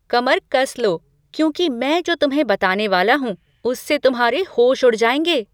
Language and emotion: Hindi, surprised